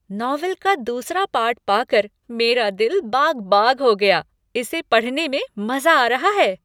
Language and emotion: Hindi, happy